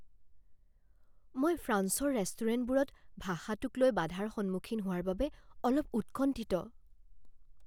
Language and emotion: Assamese, fearful